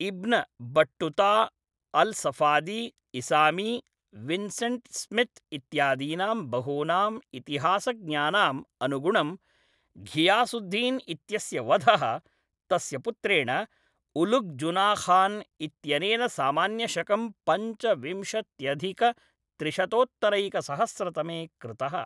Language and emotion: Sanskrit, neutral